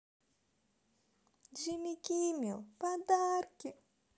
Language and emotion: Russian, positive